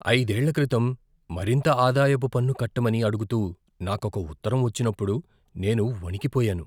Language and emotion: Telugu, fearful